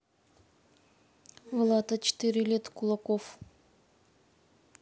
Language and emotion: Russian, neutral